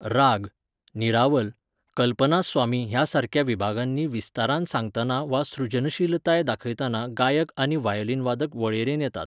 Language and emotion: Goan Konkani, neutral